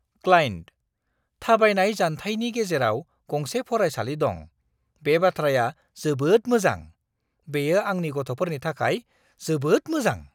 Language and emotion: Bodo, surprised